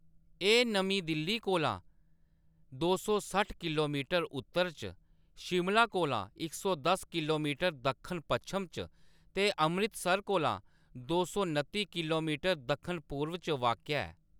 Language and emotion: Dogri, neutral